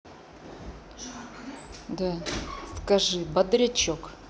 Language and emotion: Russian, neutral